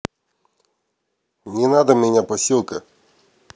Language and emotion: Russian, angry